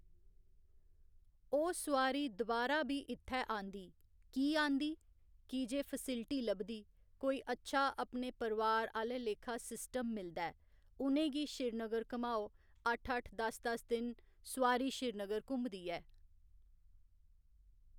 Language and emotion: Dogri, neutral